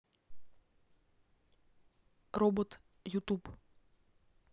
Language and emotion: Russian, neutral